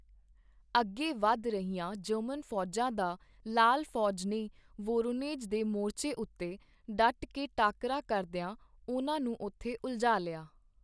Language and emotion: Punjabi, neutral